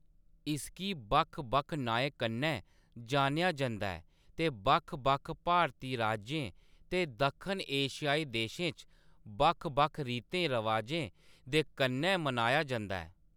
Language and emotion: Dogri, neutral